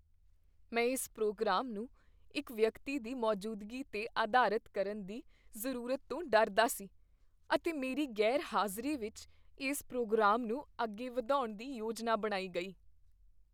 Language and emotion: Punjabi, fearful